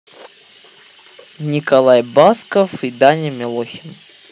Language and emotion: Russian, neutral